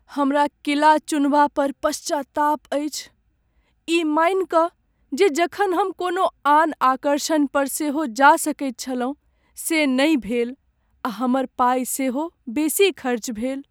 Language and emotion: Maithili, sad